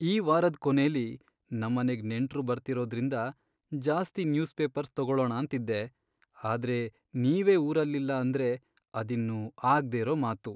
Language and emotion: Kannada, sad